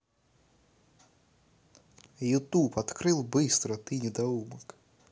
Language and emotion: Russian, angry